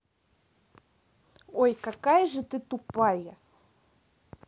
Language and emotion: Russian, angry